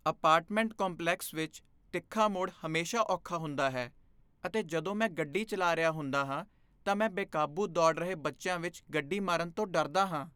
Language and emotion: Punjabi, fearful